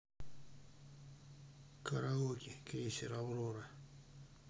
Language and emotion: Russian, sad